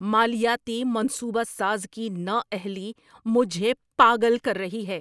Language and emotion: Urdu, angry